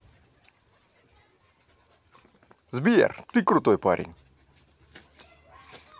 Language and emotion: Russian, positive